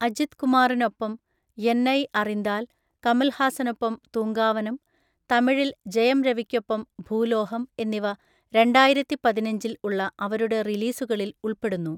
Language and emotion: Malayalam, neutral